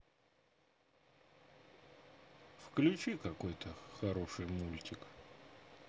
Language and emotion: Russian, neutral